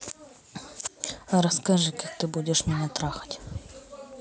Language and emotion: Russian, neutral